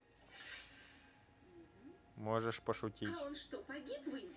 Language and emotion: Russian, neutral